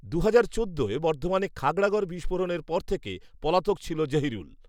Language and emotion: Bengali, neutral